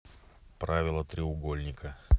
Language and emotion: Russian, neutral